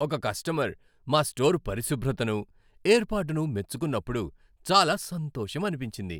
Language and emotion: Telugu, happy